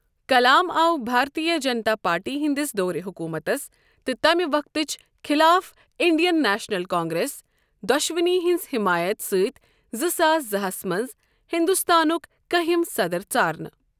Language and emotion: Kashmiri, neutral